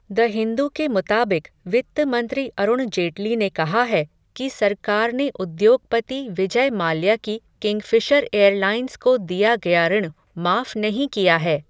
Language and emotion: Hindi, neutral